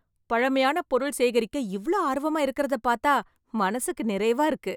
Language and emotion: Tamil, happy